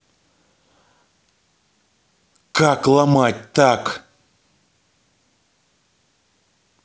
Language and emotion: Russian, angry